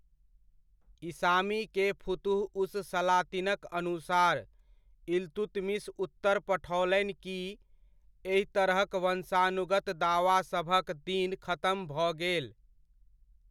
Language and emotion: Maithili, neutral